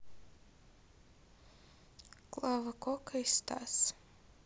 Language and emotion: Russian, neutral